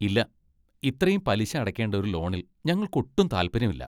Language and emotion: Malayalam, disgusted